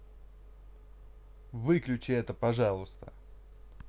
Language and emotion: Russian, angry